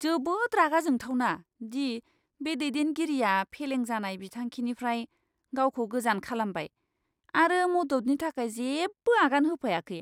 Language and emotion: Bodo, disgusted